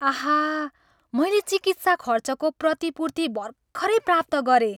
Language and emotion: Nepali, happy